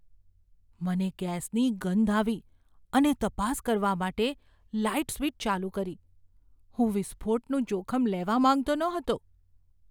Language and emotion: Gujarati, fearful